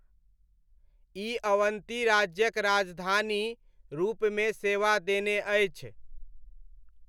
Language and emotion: Maithili, neutral